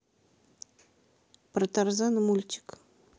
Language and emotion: Russian, neutral